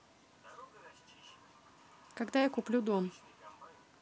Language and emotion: Russian, neutral